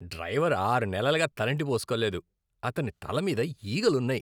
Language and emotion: Telugu, disgusted